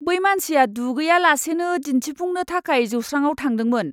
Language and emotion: Bodo, disgusted